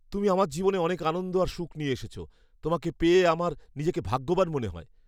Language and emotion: Bengali, happy